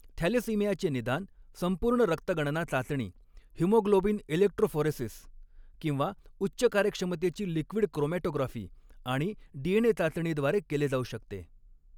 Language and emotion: Marathi, neutral